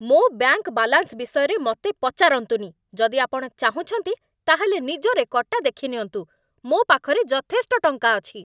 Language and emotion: Odia, angry